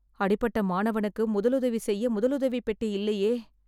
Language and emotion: Tamil, fearful